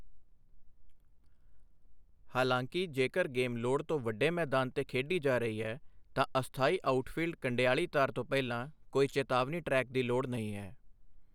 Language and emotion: Punjabi, neutral